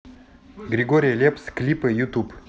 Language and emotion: Russian, neutral